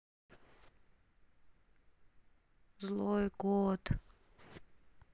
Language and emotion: Russian, sad